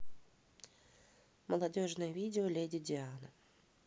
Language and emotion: Russian, neutral